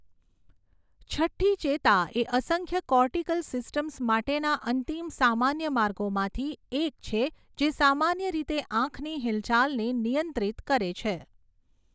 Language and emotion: Gujarati, neutral